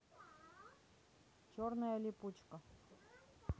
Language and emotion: Russian, neutral